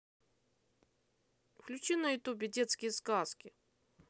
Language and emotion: Russian, neutral